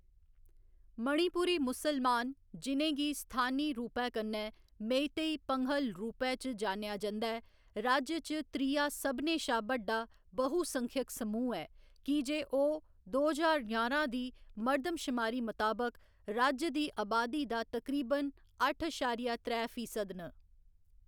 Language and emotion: Dogri, neutral